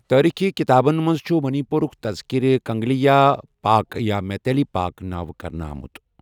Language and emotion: Kashmiri, neutral